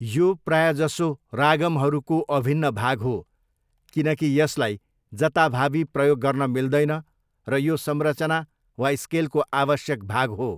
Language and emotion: Nepali, neutral